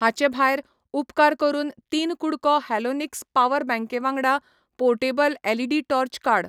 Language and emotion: Goan Konkani, neutral